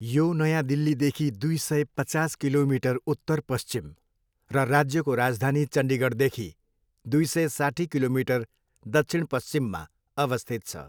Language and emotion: Nepali, neutral